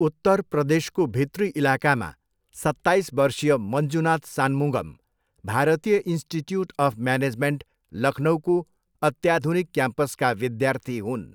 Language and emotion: Nepali, neutral